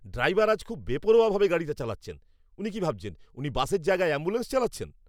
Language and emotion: Bengali, angry